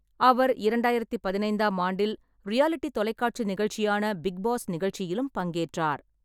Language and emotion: Tamil, neutral